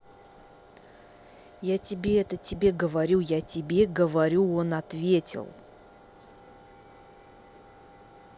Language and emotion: Russian, angry